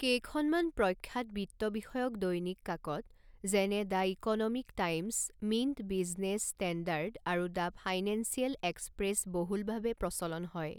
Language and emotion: Assamese, neutral